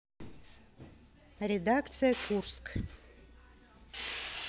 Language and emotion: Russian, neutral